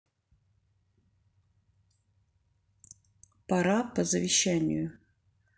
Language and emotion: Russian, neutral